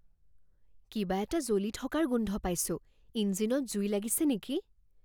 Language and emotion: Assamese, fearful